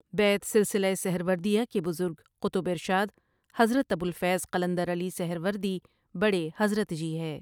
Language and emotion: Urdu, neutral